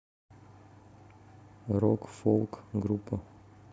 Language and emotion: Russian, neutral